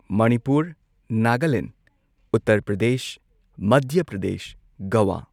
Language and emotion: Manipuri, neutral